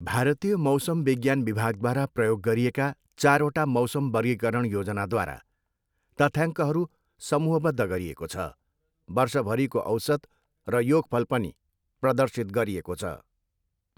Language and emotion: Nepali, neutral